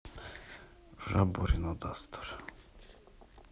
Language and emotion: Russian, sad